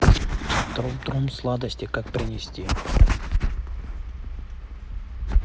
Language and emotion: Russian, neutral